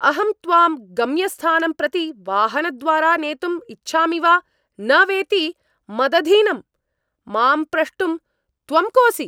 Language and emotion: Sanskrit, angry